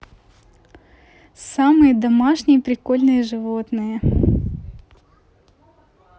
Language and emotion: Russian, neutral